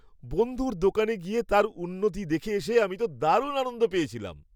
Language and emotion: Bengali, happy